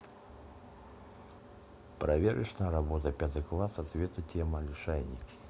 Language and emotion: Russian, neutral